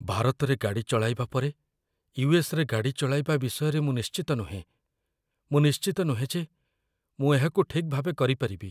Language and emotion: Odia, fearful